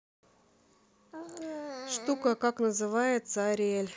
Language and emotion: Russian, neutral